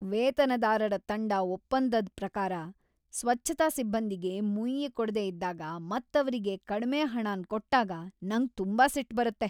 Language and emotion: Kannada, angry